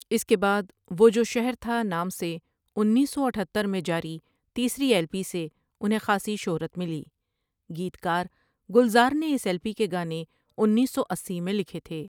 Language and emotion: Urdu, neutral